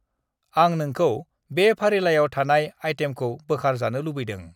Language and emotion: Bodo, neutral